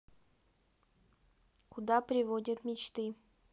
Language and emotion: Russian, neutral